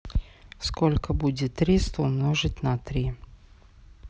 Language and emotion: Russian, neutral